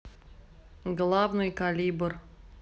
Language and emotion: Russian, neutral